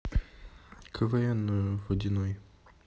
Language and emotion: Russian, neutral